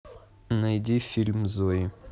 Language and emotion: Russian, neutral